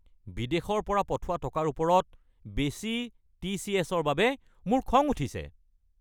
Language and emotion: Assamese, angry